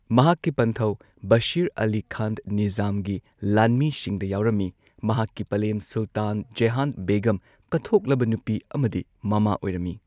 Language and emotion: Manipuri, neutral